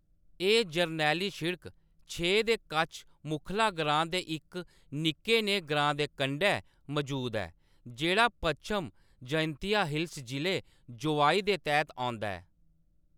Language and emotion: Dogri, neutral